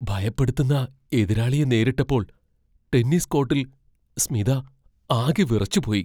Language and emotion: Malayalam, fearful